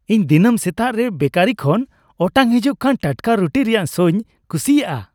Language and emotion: Santali, happy